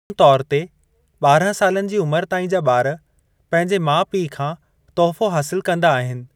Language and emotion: Sindhi, neutral